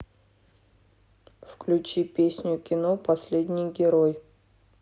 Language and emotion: Russian, neutral